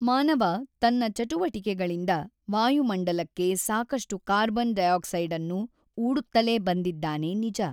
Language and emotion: Kannada, neutral